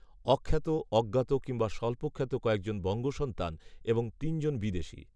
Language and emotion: Bengali, neutral